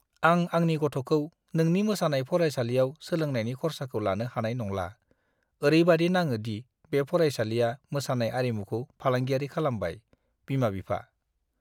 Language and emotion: Bodo, disgusted